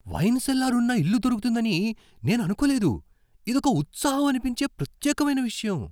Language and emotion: Telugu, surprised